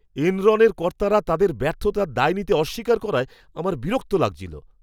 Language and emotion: Bengali, disgusted